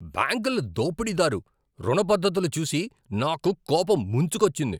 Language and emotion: Telugu, angry